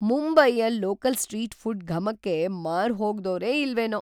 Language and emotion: Kannada, surprised